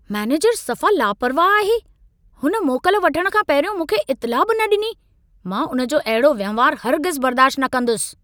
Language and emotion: Sindhi, angry